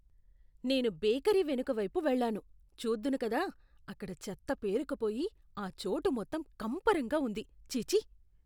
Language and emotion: Telugu, disgusted